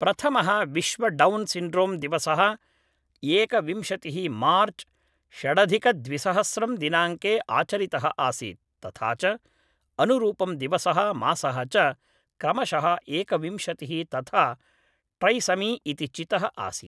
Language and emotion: Sanskrit, neutral